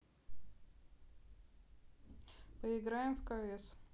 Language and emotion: Russian, neutral